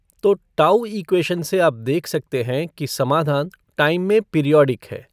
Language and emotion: Hindi, neutral